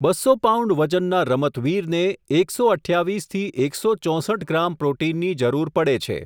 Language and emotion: Gujarati, neutral